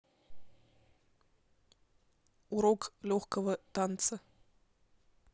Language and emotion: Russian, neutral